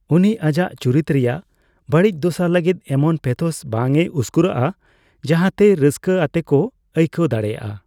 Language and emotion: Santali, neutral